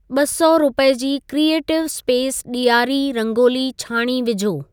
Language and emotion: Sindhi, neutral